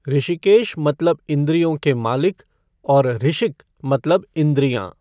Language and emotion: Hindi, neutral